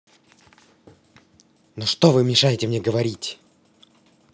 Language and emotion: Russian, angry